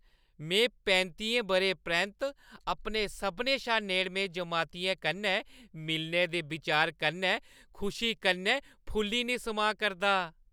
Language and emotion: Dogri, happy